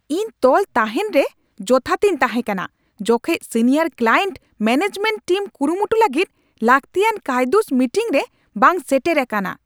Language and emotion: Santali, angry